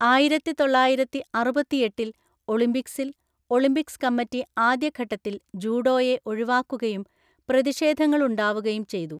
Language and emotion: Malayalam, neutral